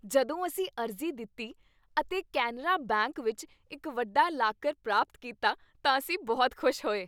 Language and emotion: Punjabi, happy